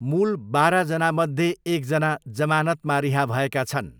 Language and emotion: Nepali, neutral